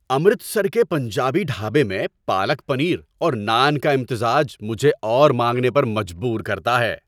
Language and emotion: Urdu, happy